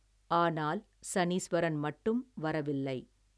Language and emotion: Tamil, neutral